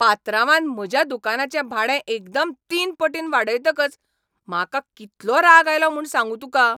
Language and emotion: Goan Konkani, angry